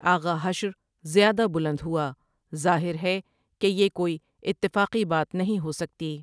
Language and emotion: Urdu, neutral